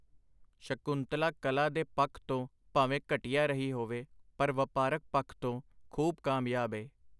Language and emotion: Punjabi, neutral